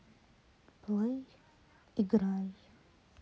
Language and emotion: Russian, neutral